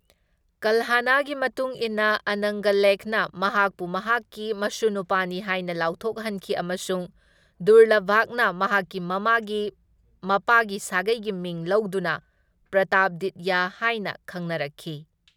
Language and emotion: Manipuri, neutral